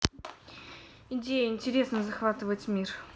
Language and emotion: Russian, neutral